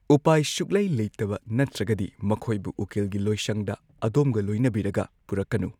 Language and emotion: Manipuri, neutral